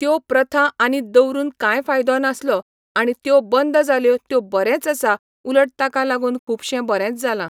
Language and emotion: Goan Konkani, neutral